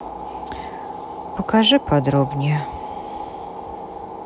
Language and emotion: Russian, sad